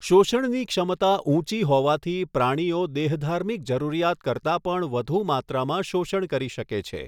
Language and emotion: Gujarati, neutral